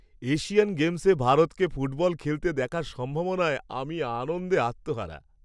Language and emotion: Bengali, happy